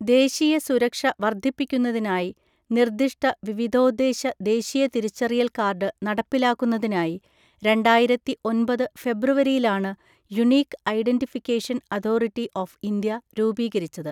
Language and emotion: Malayalam, neutral